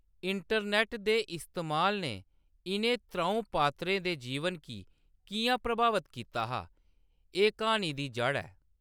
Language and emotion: Dogri, neutral